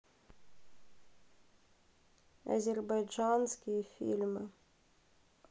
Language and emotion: Russian, neutral